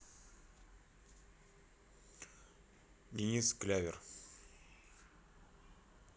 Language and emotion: Russian, neutral